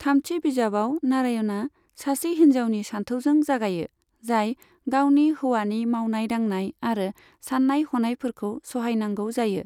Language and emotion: Bodo, neutral